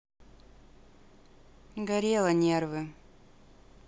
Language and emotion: Russian, neutral